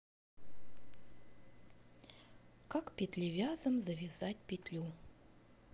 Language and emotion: Russian, neutral